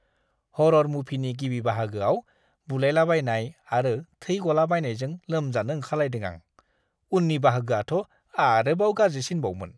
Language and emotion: Bodo, disgusted